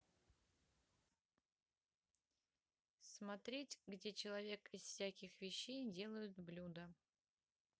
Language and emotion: Russian, neutral